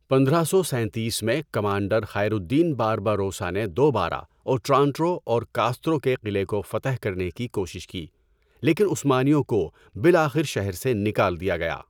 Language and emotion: Urdu, neutral